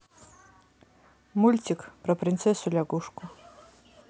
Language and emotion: Russian, neutral